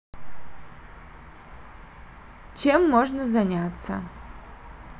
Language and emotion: Russian, neutral